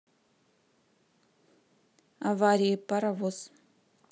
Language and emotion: Russian, neutral